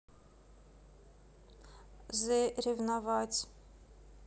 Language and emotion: Russian, neutral